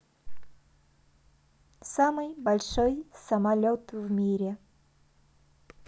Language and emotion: Russian, positive